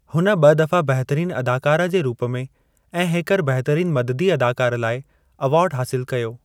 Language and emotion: Sindhi, neutral